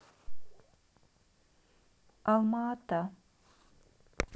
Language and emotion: Russian, neutral